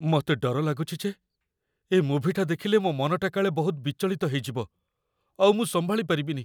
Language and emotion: Odia, fearful